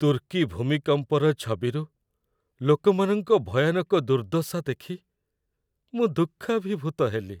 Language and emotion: Odia, sad